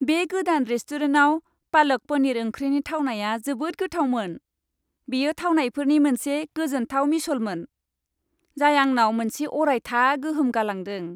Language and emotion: Bodo, happy